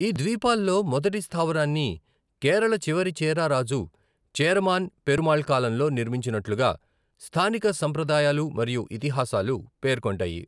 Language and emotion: Telugu, neutral